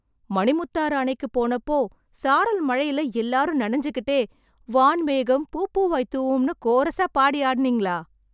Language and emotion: Tamil, surprised